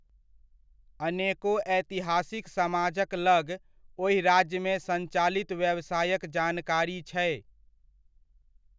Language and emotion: Maithili, neutral